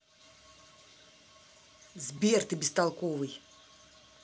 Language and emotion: Russian, angry